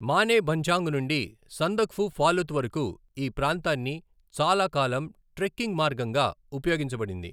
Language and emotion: Telugu, neutral